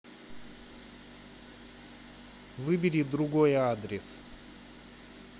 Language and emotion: Russian, neutral